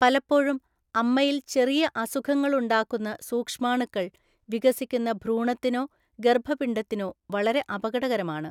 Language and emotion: Malayalam, neutral